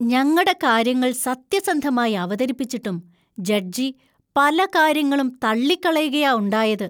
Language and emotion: Malayalam, disgusted